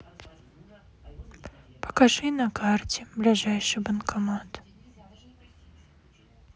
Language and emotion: Russian, sad